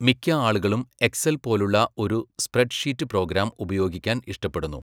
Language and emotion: Malayalam, neutral